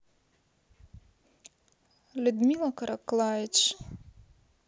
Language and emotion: Russian, neutral